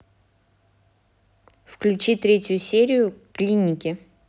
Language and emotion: Russian, neutral